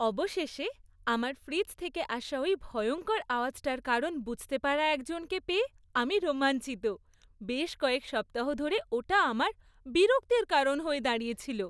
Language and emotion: Bengali, happy